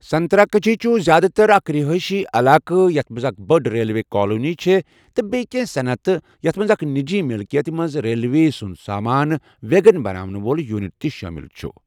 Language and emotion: Kashmiri, neutral